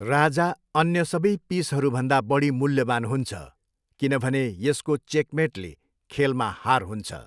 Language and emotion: Nepali, neutral